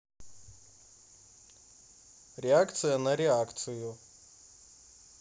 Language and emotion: Russian, neutral